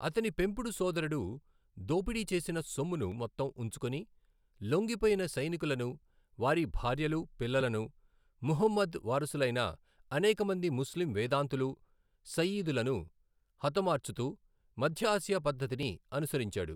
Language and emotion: Telugu, neutral